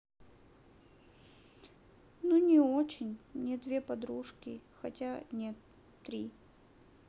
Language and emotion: Russian, neutral